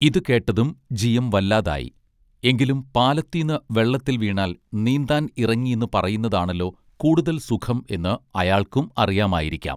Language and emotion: Malayalam, neutral